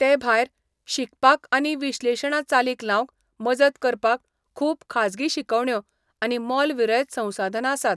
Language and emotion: Goan Konkani, neutral